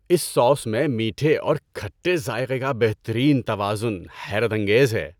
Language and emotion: Urdu, happy